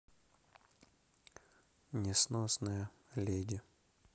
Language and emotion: Russian, neutral